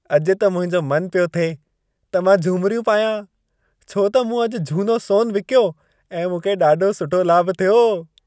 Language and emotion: Sindhi, happy